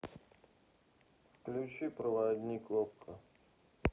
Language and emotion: Russian, sad